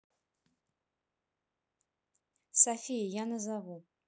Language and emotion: Russian, neutral